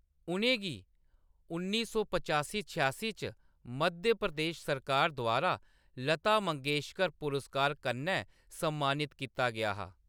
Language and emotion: Dogri, neutral